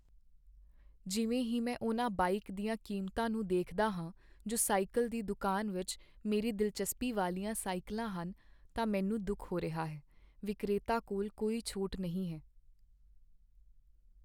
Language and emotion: Punjabi, sad